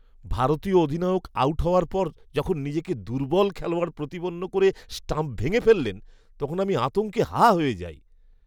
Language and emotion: Bengali, disgusted